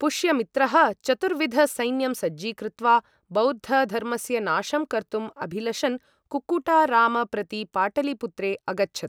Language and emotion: Sanskrit, neutral